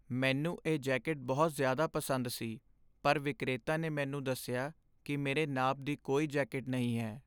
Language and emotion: Punjabi, sad